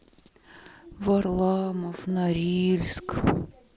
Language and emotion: Russian, sad